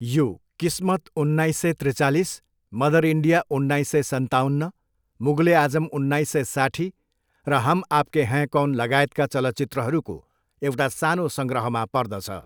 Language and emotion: Nepali, neutral